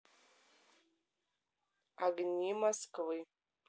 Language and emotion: Russian, neutral